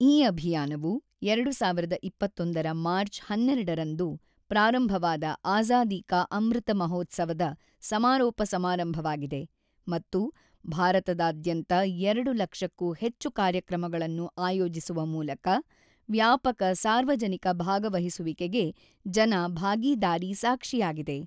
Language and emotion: Kannada, neutral